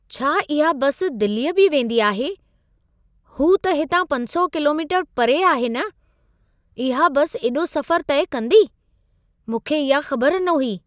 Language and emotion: Sindhi, surprised